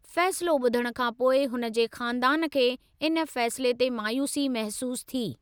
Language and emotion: Sindhi, neutral